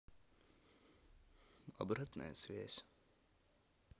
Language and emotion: Russian, neutral